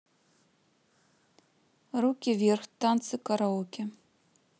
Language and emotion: Russian, neutral